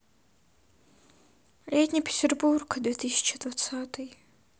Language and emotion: Russian, sad